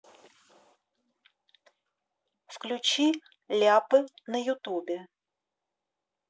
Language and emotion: Russian, neutral